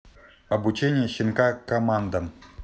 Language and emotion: Russian, neutral